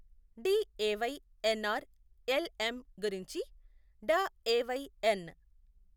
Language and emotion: Telugu, neutral